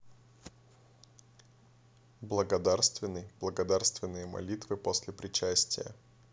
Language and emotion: Russian, neutral